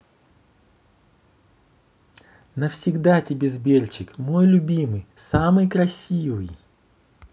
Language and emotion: Russian, positive